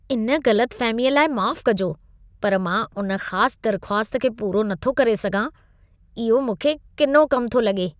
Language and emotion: Sindhi, disgusted